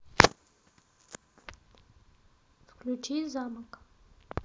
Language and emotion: Russian, neutral